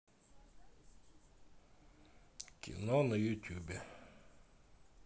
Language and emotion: Russian, neutral